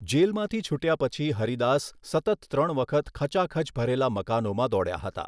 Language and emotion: Gujarati, neutral